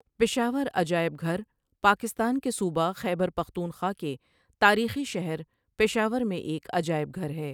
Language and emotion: Urdu, neutral